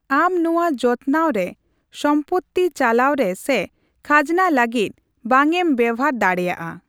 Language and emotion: Santali, neutral